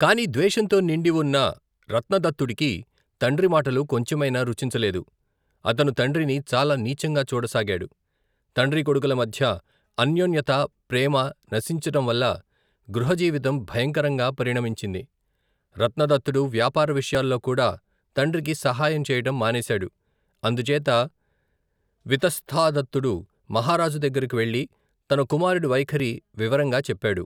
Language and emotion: Telugu, neutral